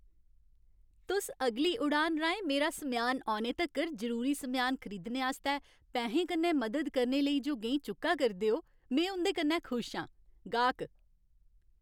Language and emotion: Dogri, happy